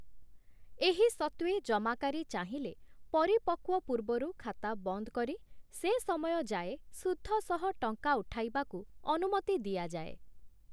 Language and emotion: Odia, neutral